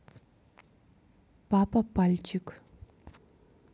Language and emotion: Russian, neutral